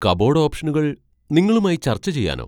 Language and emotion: Malayalam, surprised